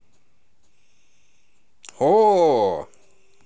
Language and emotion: Russian, positive